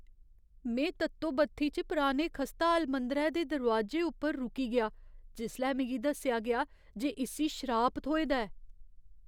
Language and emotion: Dogri, fearful